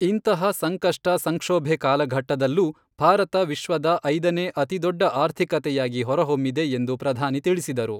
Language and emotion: Kannada, neutral